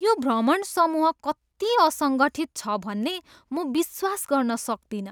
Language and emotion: Nepali, disgusted